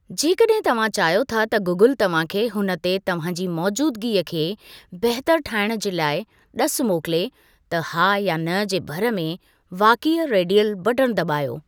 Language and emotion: Sindhi, neutral